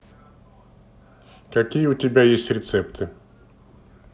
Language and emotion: Russian, neutral